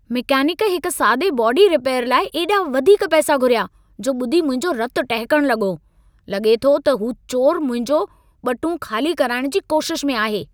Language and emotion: Sindhi, angry